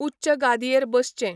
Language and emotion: Goan Konkani, neutral